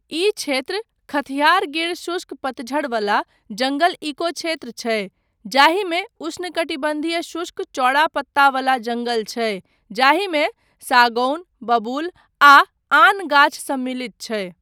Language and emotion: Maithili, neutral